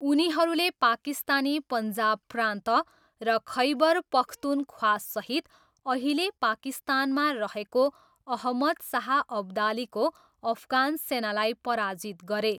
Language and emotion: Nepali, neutral